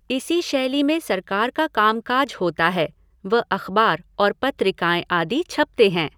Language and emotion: Hindi, neutral